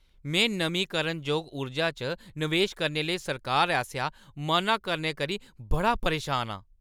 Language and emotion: Dogri, angry